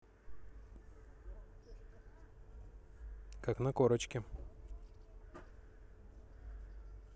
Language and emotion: Russian, neutral